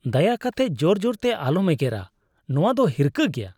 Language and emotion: Santali, disgusted